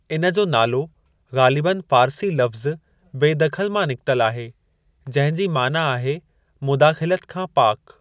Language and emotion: Sindhi, neutral